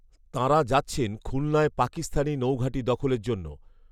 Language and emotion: Bengali, neutral